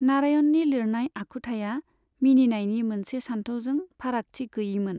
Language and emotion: Bodo, neutral